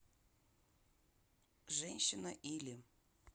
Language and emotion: Russian, neutral